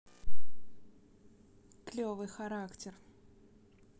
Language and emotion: Russian, neutral